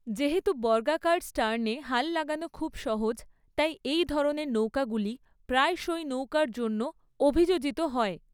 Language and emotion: Bengali, neutral